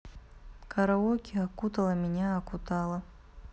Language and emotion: Russian, neutral